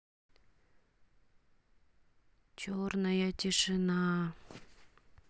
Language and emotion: Russian, neutral